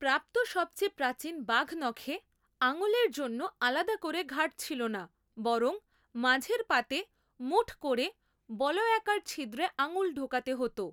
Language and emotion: Bengali, neutral